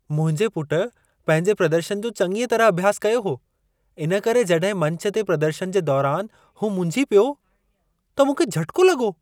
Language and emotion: Sindhi, surprised